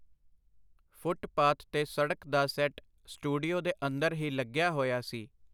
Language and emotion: Punjabi, neutral